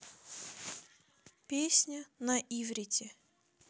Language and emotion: Russian, neutral